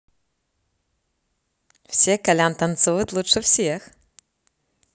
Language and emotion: Russian, positive